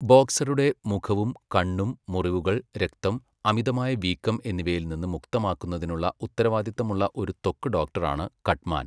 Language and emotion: Malayalam, neutral